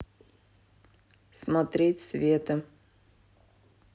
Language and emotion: Russian, neutral